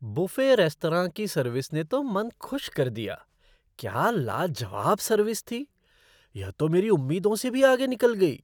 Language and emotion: Hindi, surprised